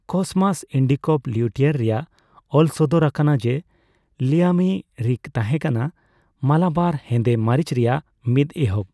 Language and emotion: Santali, neutral